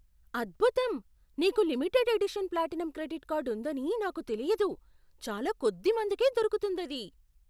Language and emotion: Telugu, surprised